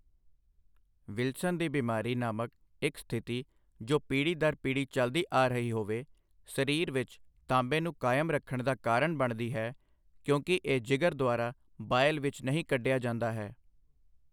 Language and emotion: Punjabi, neutral